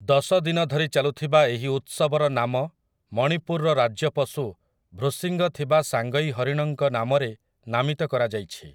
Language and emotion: Odia, neutral